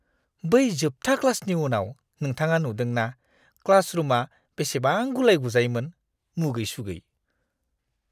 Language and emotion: Bodo, disgusted